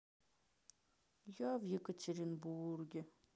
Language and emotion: Russian, sad